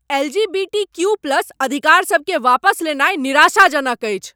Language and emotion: Maithili, angry